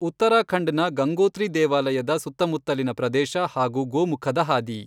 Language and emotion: Kannada, neutral